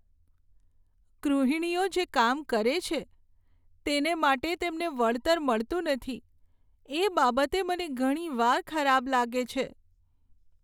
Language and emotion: Gujarati, sad